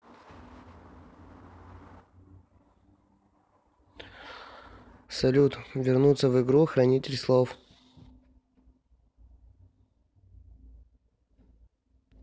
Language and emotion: Russian, neutral